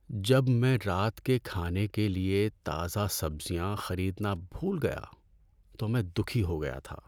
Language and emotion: Urdu, sad